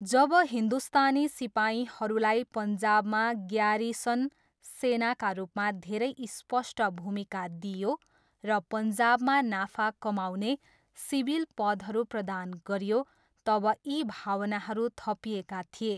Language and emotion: Nepali, neutral